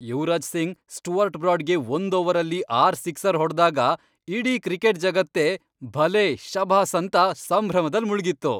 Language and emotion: Kannada, happy